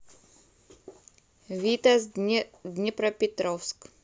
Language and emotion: Russian, neutral